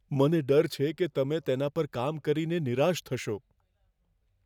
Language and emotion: Gujarati, fearful